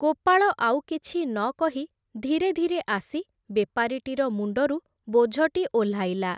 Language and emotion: Odia, neutral